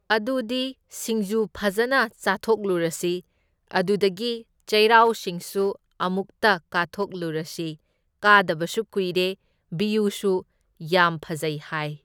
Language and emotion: Manipuri, neutral